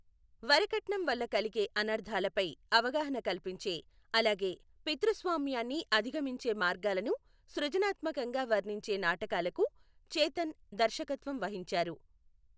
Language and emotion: Telugu, neutral